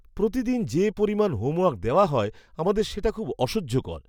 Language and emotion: Bengali, disgusted